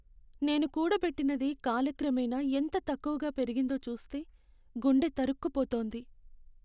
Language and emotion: Telugu, sad